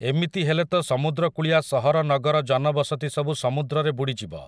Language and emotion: Odia, neutral